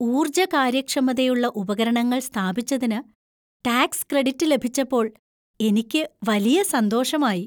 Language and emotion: Malayalam, happy